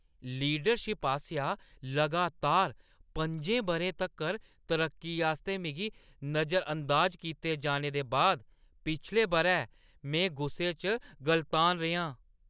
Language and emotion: Dogri, angry